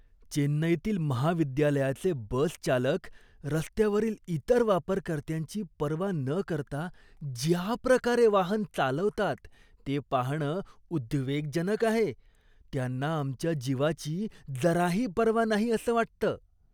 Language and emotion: Marathi, disgusted